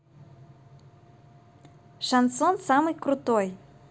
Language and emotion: Russian, positive